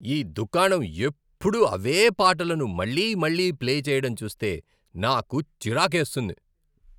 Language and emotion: Telugu, angry